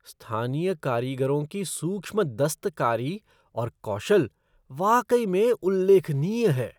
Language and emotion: Hindi, surprised